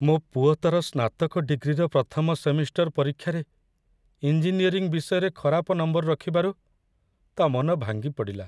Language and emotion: Odia, sad